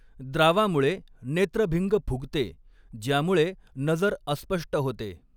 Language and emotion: Marathi, neutral